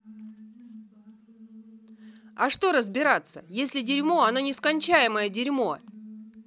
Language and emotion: Russian, angry